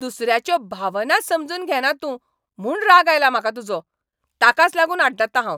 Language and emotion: Goan Konkani, angry